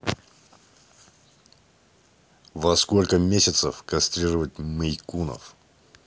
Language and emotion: Russian, neutral